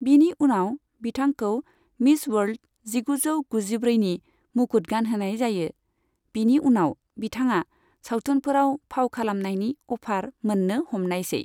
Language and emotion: Bodo, neutral